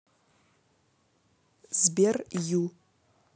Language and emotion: Russian, neutral